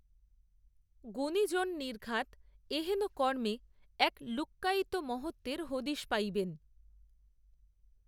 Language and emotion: Bengali, neutral